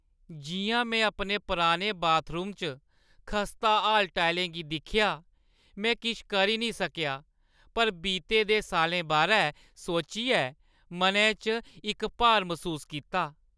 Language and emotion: Dogri, sad